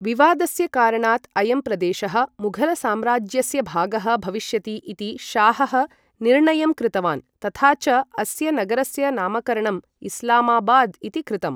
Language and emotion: Sanskrit, neutral